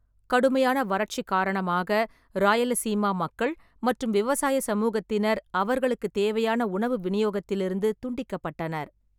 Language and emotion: Tamil, neutral